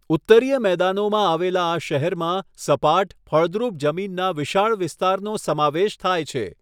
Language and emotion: Gujarati, neutral